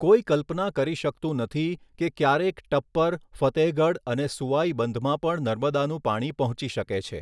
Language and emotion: Gujarati, neutral